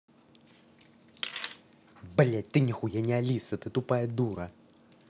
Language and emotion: Russian, angry